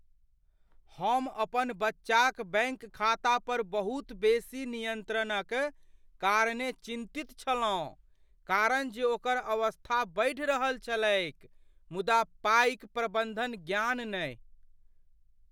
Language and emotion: Maithili, fearful